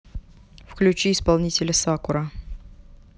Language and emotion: Russian, neutral